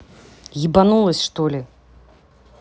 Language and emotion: Russian, angry